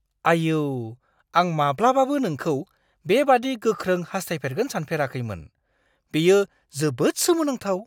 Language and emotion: Bodo, surprised